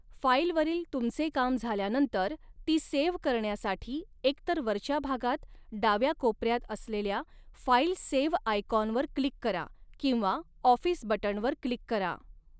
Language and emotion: Marathi, neutral